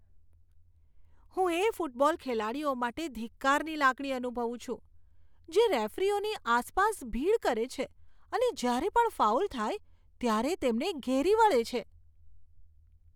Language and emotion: Gujarati, disgusted